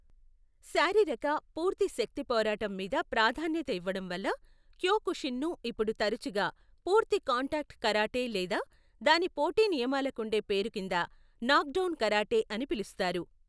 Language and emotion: Telugu, neutral